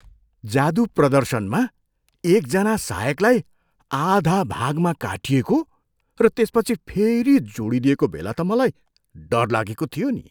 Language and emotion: Nepali, surprised